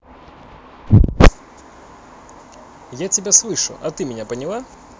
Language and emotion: Russian, neutral